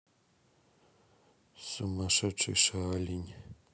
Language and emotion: Russian, neutral